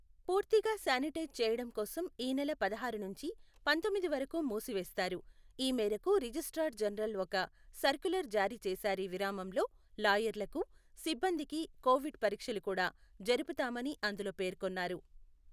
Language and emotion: Telugu, neutral